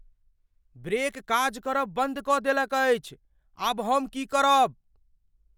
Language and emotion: Maithili, fearful